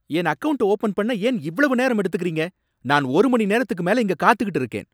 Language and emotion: Tamil, angry